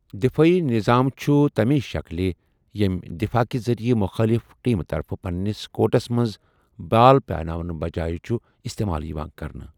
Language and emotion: Kashmiri, neutral